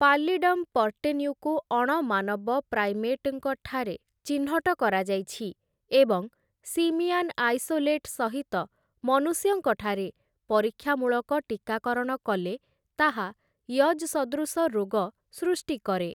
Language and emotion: Odia, neutral